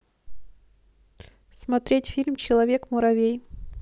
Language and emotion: Russian, neutral